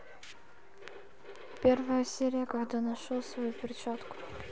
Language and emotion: Russian, neutral